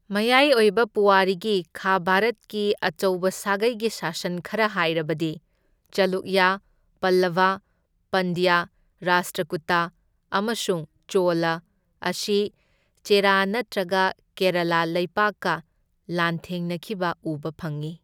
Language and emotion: Manipuri, neutral